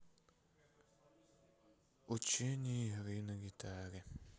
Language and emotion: Russian, sad